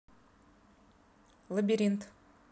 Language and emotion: Russian, neutral